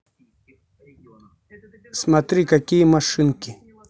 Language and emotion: Russian, neutral